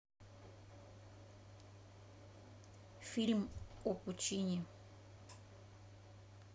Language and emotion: Russian, neutral